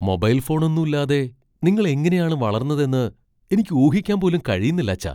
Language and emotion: Malayalam, surprised